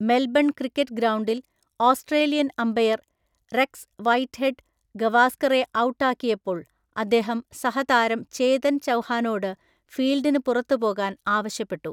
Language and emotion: Malayalam, neutral